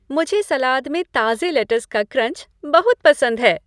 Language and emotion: Hindi, happy